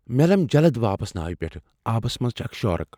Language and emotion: Kashmiri, fearful